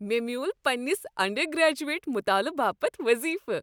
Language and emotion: Kashmiri, happy